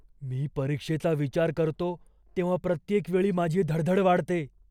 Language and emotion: Marathi, fearful